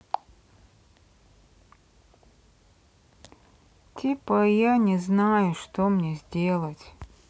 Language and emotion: Russian, sad